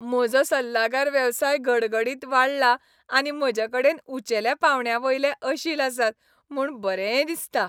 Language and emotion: Goan Konkani, happy